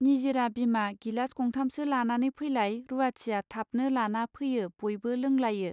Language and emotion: Bodo, neutral